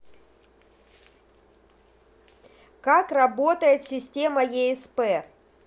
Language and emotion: Russian, neutral